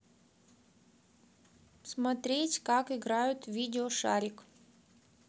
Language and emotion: Russian, neutral